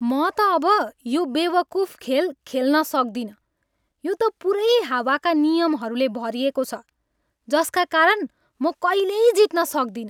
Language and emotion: Nepali, angry